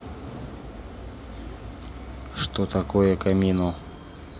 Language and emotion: Russian, neutral